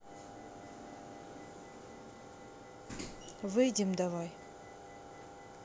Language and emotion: Russian, neutral